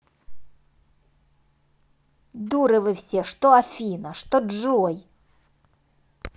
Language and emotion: Russian, angry